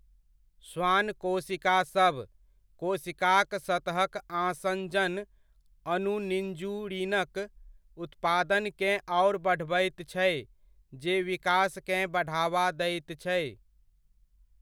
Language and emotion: Maithili, neutral